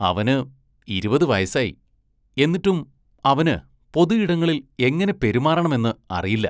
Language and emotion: Malayalam, disgusted